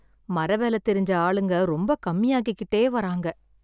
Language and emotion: Tamil, sad